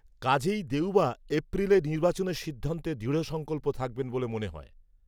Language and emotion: Bengali, neutral